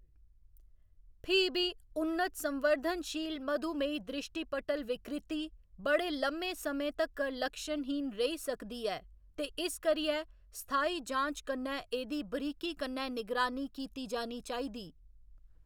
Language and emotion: Dogri, neutral